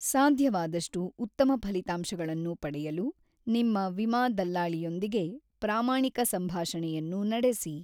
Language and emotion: Kannada, neutral